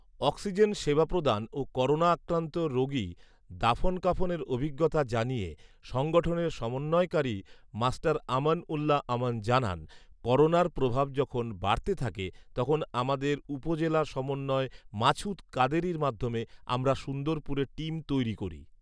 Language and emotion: Bengali, neutral